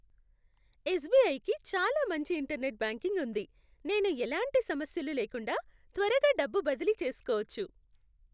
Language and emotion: Telugu, happy